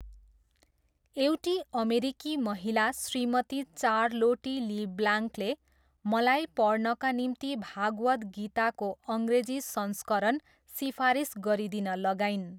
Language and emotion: Nepali, neutral